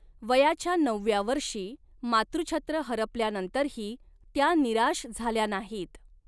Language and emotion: Marathi, neutral